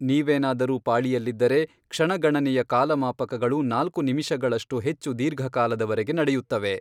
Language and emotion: Kannada, neutral